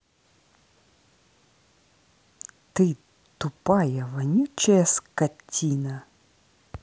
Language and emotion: Russian, angry